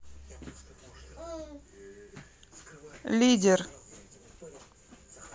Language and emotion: Russian, neutral